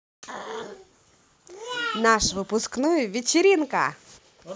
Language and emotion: Russian, positive